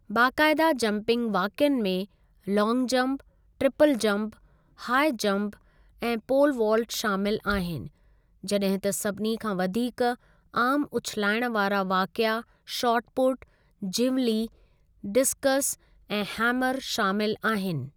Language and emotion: Sindhi, neutral